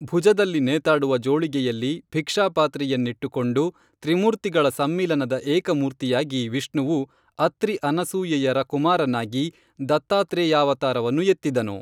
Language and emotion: Kannada, neutral